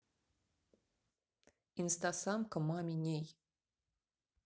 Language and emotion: Russian, neutral